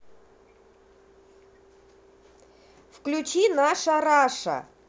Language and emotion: Russian, angry